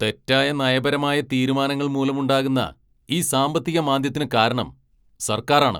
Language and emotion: Malayalam, angry